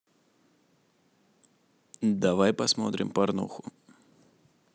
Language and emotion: Russian, neutral